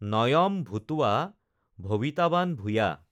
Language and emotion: Assamese, neutral